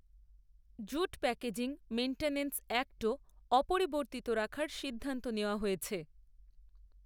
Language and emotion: Bengali, neutral